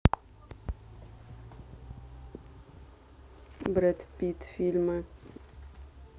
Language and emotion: Russian, neutral